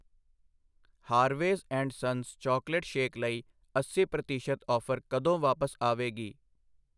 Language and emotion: Punjabi, neutral